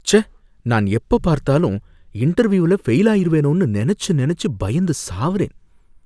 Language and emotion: Tamil, fearful